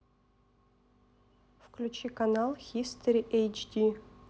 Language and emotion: Russian, neutral